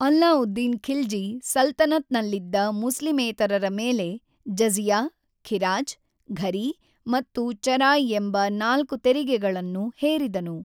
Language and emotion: Kannada, neutral